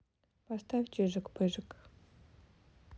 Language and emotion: Russian, neutral